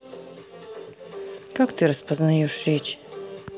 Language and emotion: Russian, neutral